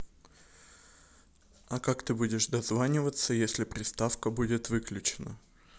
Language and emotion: Russian, neutral